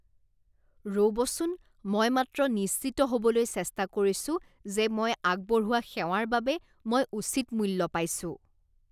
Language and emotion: Assamese, disgusted